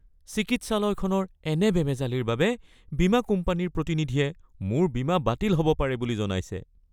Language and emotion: Assamese, fearful